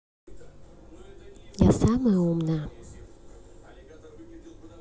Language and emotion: Russian, neutral